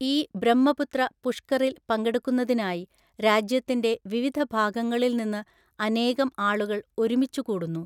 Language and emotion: Malayalam, neutral